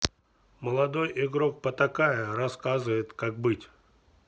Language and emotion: Russian, neutral